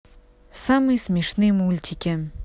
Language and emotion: Russian, neutral